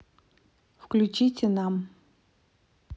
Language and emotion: Russian, neutral